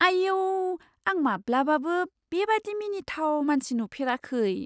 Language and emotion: Bodo, surprised